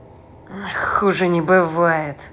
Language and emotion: Russian, angry